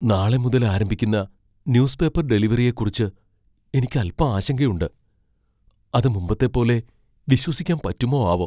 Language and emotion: Malayalam, fearful